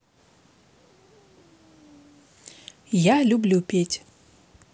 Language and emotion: Russian, neutral